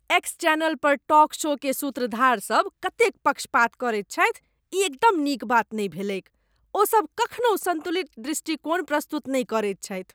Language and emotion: Maithili, disgusted